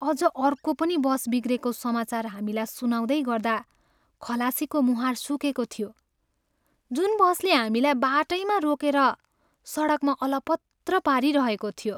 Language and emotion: Nepali, sad